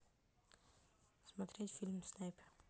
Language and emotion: Russian, neutral